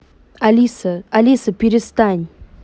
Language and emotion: Russian, neutral